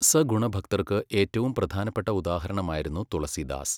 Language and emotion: Malayalam, neutral